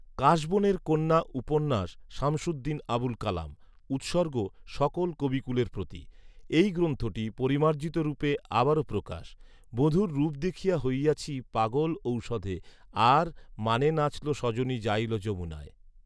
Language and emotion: Bengali, neutral